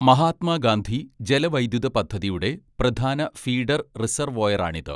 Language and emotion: Malayalam, neutral